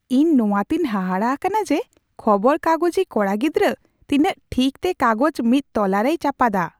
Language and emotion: Santali, surprised